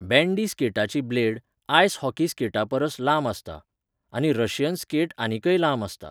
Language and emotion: Goan Konkani, neutral